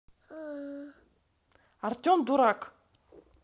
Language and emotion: Russian, angry